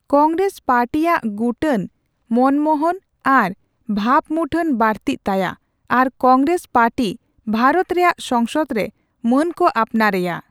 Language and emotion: Santali, neutral